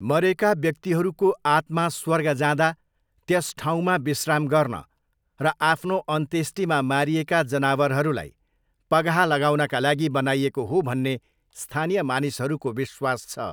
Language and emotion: Nepali, neutral